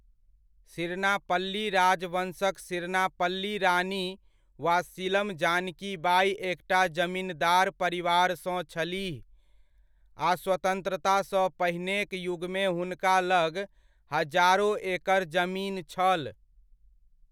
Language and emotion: Maithili, neutral